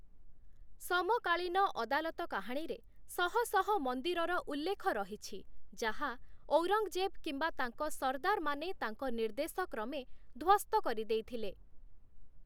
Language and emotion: Odia, neutral